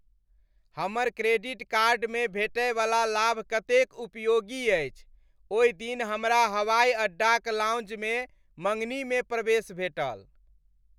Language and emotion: Maithili, happy